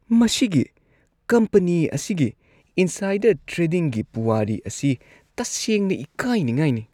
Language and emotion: Manipuri, disgusted